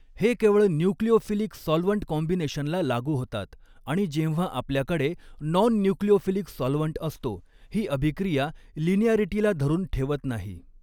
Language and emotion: Marathi, neutral